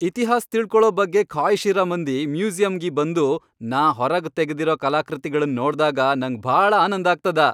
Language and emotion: Kannada, happy